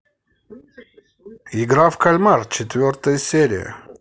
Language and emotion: Russian, positive